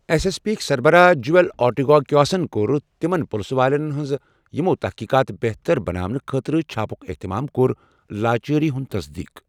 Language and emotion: Kashmiri, neutral